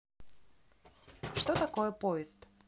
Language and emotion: Russian, neutral